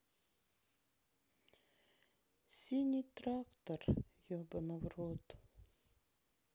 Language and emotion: Russian, sad